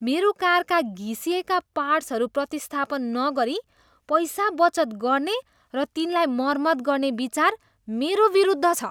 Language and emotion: Nepali, disgusted